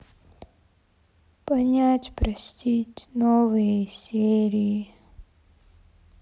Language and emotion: Russian, sad